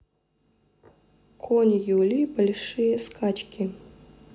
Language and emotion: Russian, neutral